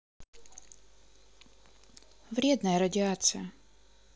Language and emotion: Russian, neutral